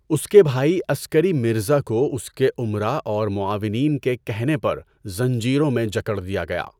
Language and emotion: Urdu, neutral